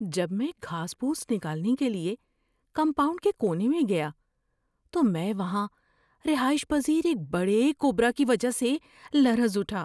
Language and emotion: Urdu, fearful